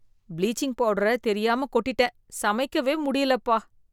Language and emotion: Tamil, disgusted